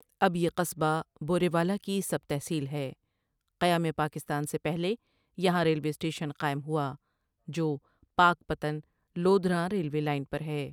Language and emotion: Urdu, neutral